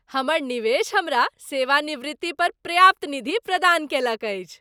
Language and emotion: Maithili, happy